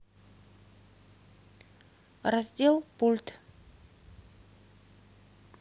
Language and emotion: Russian, neutral